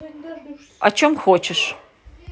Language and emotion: Russian, neutral